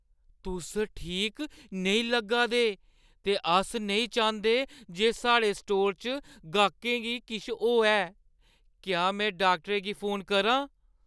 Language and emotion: Dogri, fearful